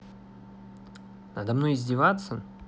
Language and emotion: Russian, neutral